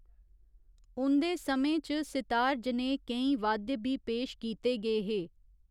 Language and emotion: Dogri, neutral